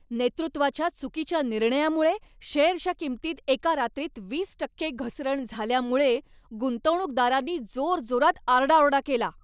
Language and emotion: Marathi, angry